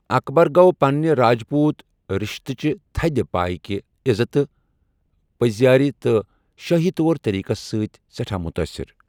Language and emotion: Kashmiri, neutral